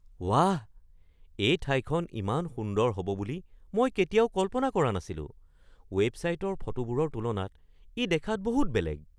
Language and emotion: Assamese, surprised